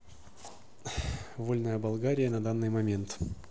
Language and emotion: Russian, neutral